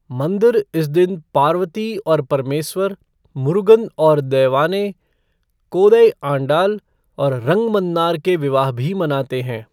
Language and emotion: Hindi, neutral